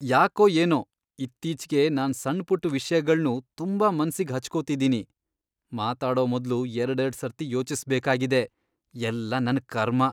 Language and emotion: Kannada, disgusted